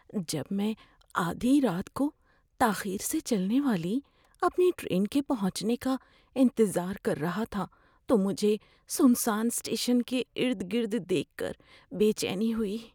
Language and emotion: Urdu, fearful